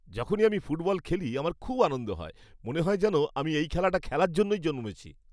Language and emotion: Bengali, happy